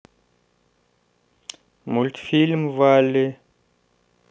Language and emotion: Russian, neutral